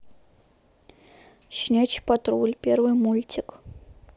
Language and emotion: Russian, neutral